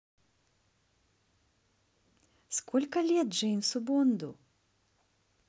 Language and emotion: Russian, positive